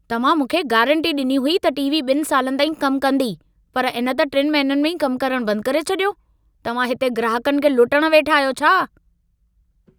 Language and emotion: Sindhi, angry